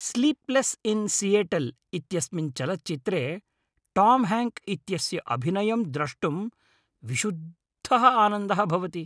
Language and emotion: Sanskrit, happy